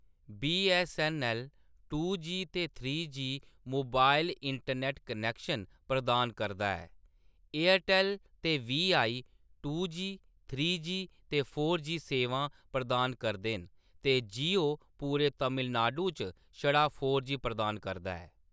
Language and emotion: Dogri, neutral